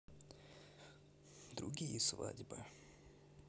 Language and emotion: Russian, sad